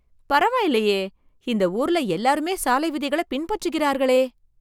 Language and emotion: Tamil, surprised